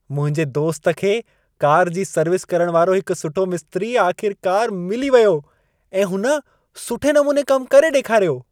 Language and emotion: Sindhi, happy